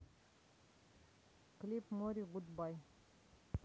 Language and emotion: Russian, neutral